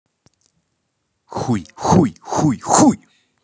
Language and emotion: Russian, angry